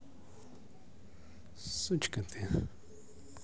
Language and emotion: Russian, positive